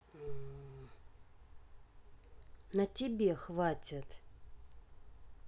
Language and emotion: Russian, neutral